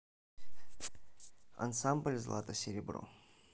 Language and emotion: Russian, neutral